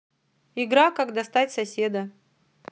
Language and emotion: Russian, neutral